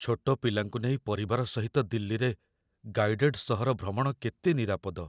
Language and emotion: Odia, fearful